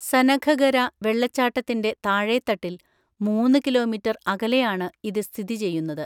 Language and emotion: Malayalam, neutral